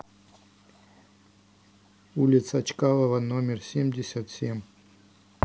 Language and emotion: Russian, neutral